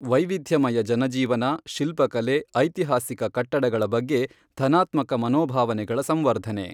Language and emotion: Kannada, neutral